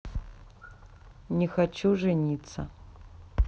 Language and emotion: Russian, sad